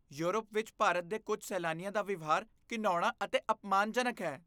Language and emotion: Punjabi, disgusted